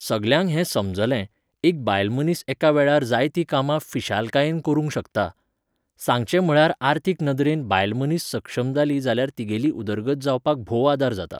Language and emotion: Goan Konkani, neutral